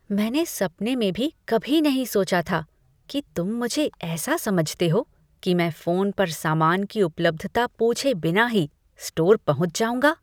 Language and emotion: Hindi, disgusted